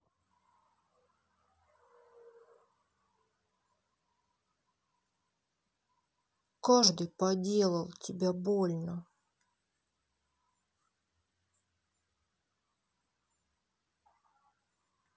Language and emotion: Russian, sad